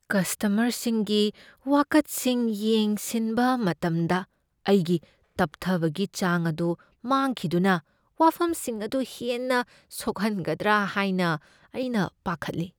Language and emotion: Manipuri, fearful